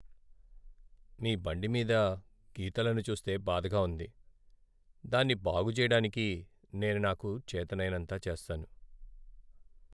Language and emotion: Telugu, sad